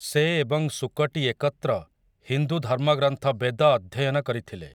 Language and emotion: Odia, neutral